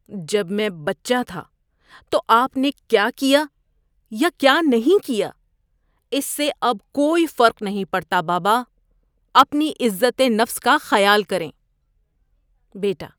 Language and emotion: Urdu, disgusted